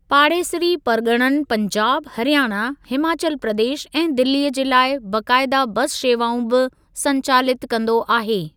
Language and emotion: Sindhi, neutral